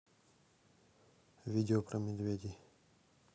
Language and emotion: Russian, neutral